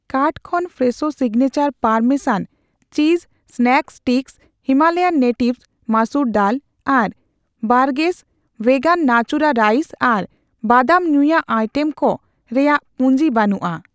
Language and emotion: Santali, neutral